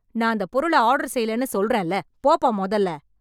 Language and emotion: Tamil, angry